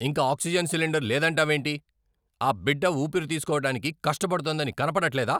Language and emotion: Telugu, angry